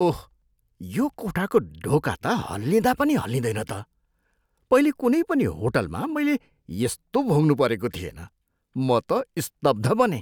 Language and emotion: Nepali, surprised